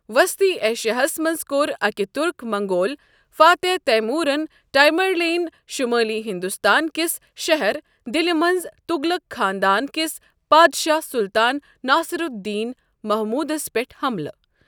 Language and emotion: Kashmiri, neutral